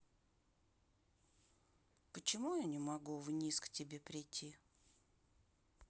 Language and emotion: Russian, sad